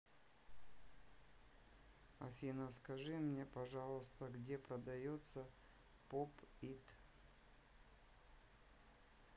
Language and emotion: Russian, neutral